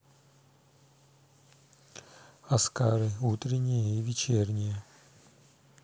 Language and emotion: Russian, neutral